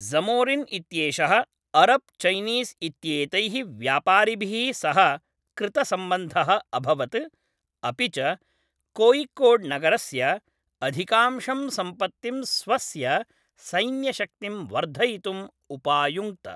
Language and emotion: Sanskrit, neutral